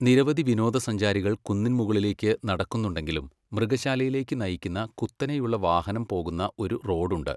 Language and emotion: Malayalam, neutral